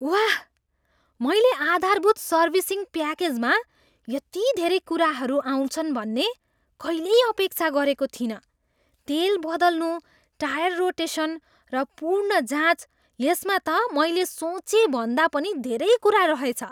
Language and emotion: Nepali, surprised